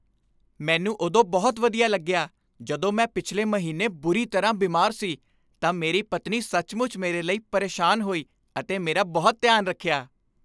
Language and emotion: Punjabi, happy